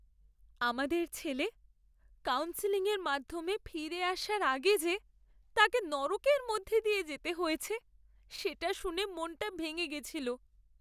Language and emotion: Bengali, sad